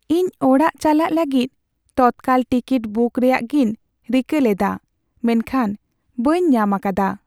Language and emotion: Santali, sad